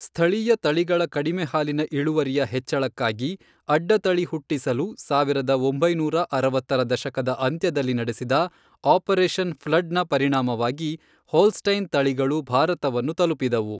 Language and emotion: Kannada, neutral